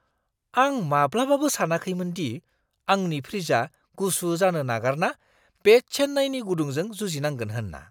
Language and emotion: Bodo, surprised